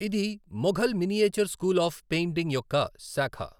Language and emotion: Telugu, neutral